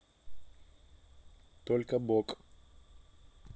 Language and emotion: Russian, neutral